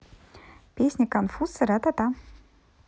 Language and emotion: Russian, positive